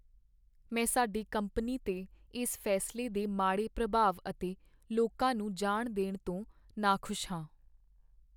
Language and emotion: Punjabi, sad